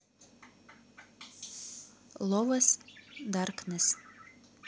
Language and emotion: Russian, neutral